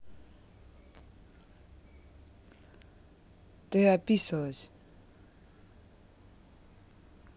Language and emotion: Russian, neutral